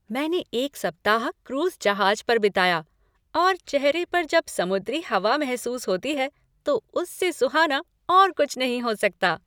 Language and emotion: Hindi, happy